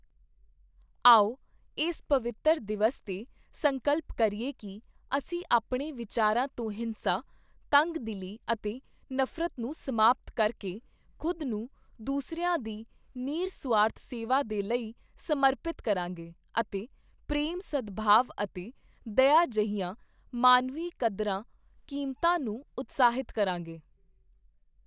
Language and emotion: Punjabi, neutral